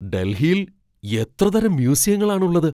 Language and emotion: Malayalam, surprised